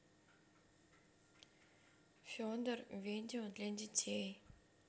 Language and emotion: Russian, neutral